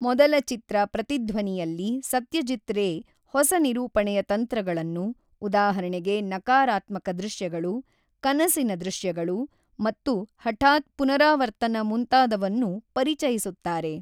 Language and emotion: Kannada, neutral